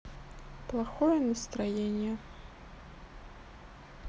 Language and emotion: Russian, sad